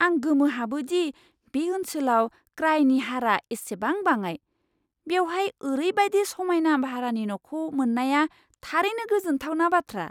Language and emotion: Bodo, surprised